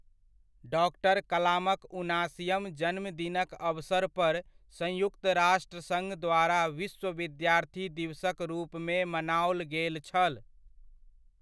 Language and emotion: Maithili, neutral